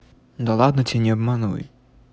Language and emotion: Russian, neutral